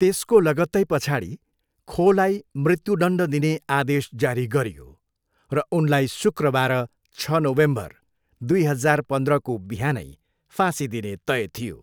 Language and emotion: Nepali, neutral